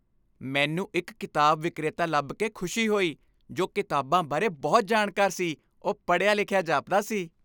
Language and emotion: Punjabi, happy